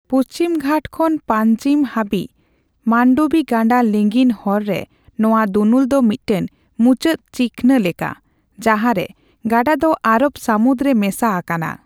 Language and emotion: Santali, neutral